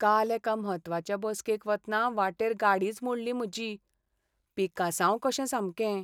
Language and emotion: Goan Konkani, sad